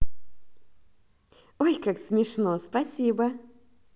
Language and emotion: Russian, positive